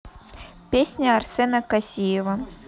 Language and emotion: Russian, neutral